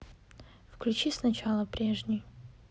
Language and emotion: Russian, neutral